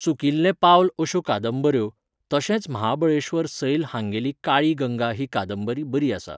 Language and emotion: Goan Konkani, neutral